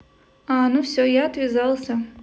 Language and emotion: Russian, neutral